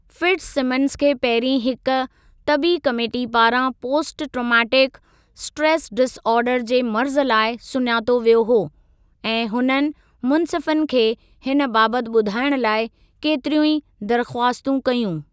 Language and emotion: Sindhi, neutral